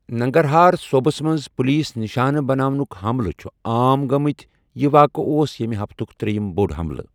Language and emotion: Kashmiri, neutral